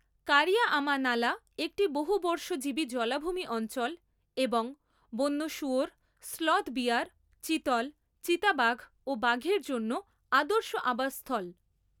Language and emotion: Bengali, neutral